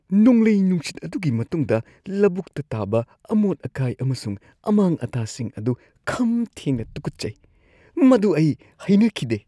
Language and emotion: Manipuri, disgusted